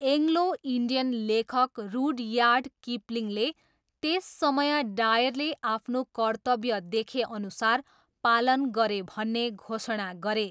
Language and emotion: Nepali, neutral